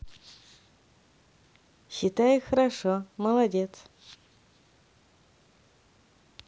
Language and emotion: Russian, positive